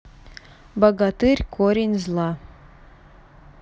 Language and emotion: Russian, neutral